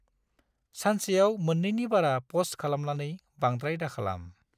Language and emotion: Bodo, neutral